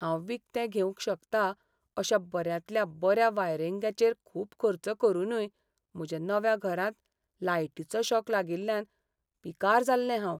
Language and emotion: Goan Konkani, sad